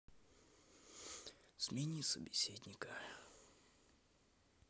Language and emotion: Russian, sad